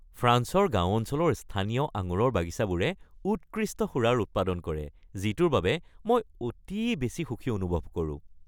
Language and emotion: Assamese, happy